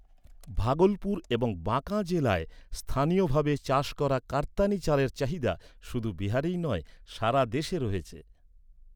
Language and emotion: Bengali, neutral